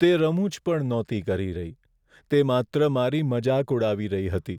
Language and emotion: Gujarati, sad